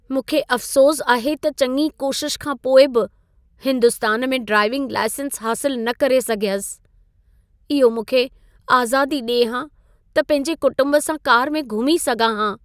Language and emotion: Sindhi, sad